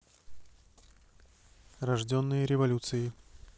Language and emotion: Russian, neutral